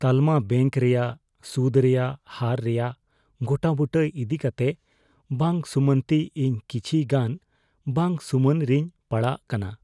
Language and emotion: Santali, fearful